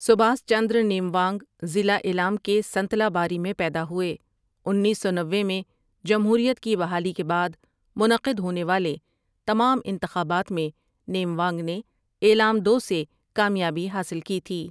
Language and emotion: Urdu, neutral